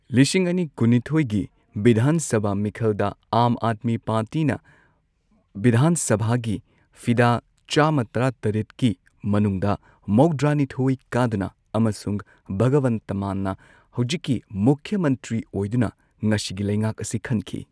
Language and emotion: Manipuri, neutral